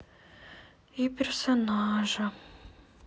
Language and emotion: Russian, sad